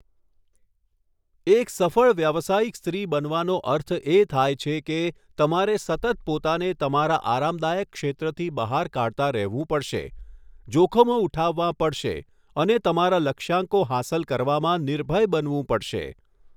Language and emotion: Gujarati, neutral